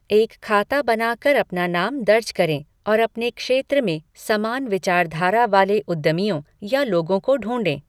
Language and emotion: Hindi, neutral